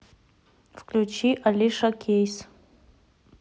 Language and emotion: Russian, neutral